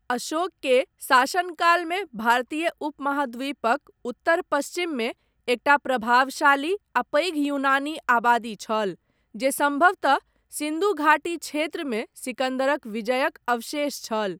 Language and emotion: Maithili, neutral